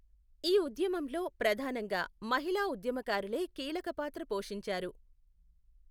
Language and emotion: Telugu, neutral